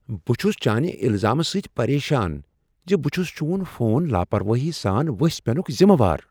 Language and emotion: Kashmiri, surprised